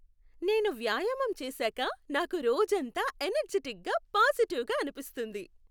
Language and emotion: Telugu, happy